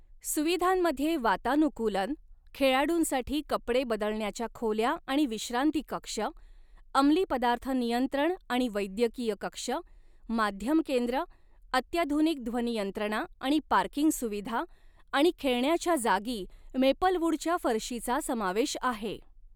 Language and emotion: Marathi, neutral